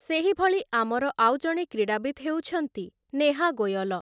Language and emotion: Odia, neutral